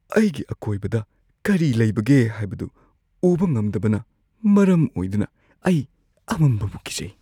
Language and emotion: Manipuri, fearful